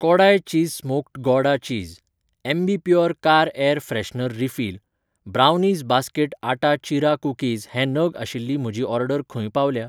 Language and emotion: Goan Konkani, neutral